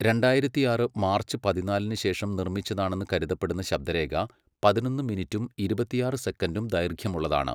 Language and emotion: Malayalam, neutral